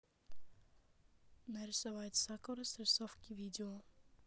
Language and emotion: Russian, neutral